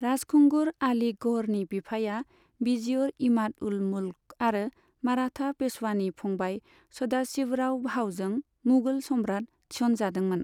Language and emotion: Bodo, neutral